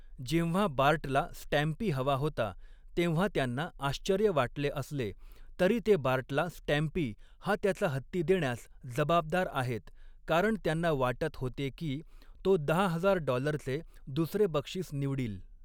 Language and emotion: Marathi, neutral